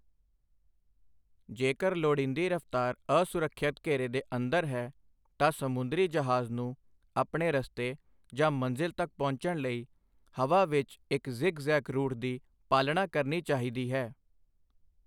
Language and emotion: Punjabi, neutral